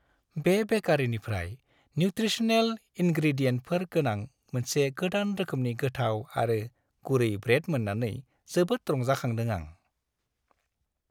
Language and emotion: Bodo, happy